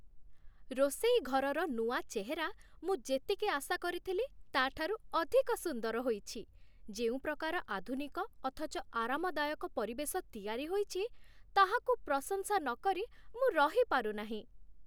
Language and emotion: Odia, happy